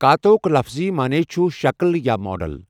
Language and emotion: Kashmiri, neutral